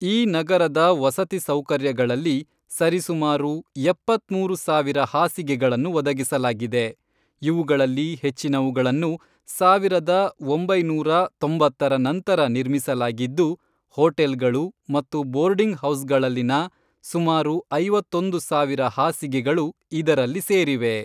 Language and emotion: Kannada, neutral